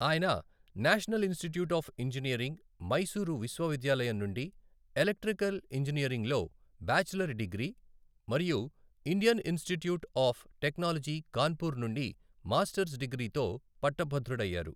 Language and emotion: Telugu, neutral